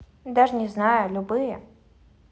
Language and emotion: Russian, neutral